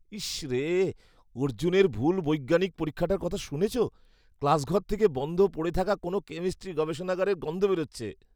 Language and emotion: Bengali, disgusted